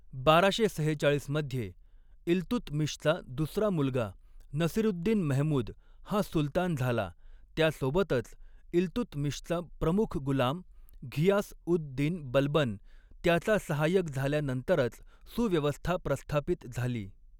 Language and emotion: Marathi, neutral